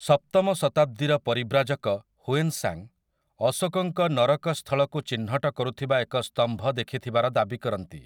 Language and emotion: Odia, neutral